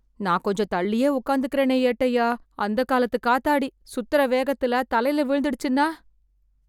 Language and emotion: Tamil, fearful